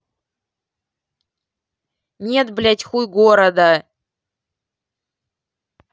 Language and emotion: Russian, angry